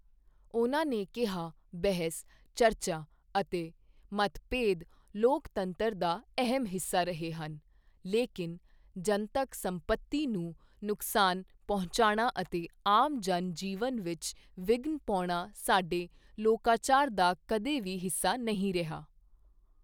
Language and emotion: Punjabi, neutral